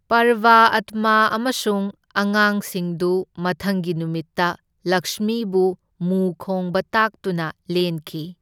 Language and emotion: Manipuri, neutral